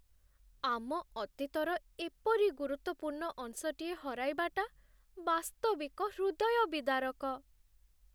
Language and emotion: Odia, sad